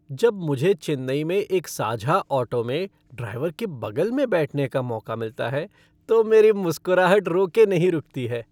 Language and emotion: Hindi, happy